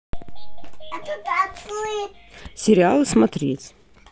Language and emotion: Russian, neutral